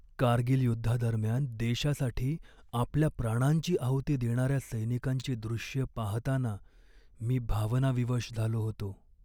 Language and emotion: Marathi, sad